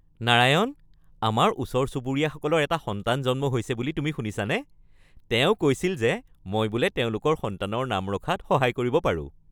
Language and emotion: Assamese, happy